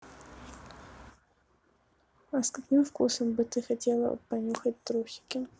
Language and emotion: Russian, neutral